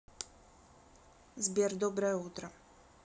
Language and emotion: Russian, neutral